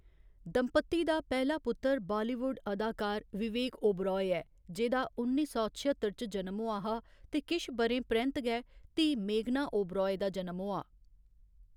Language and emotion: Dogri, neutral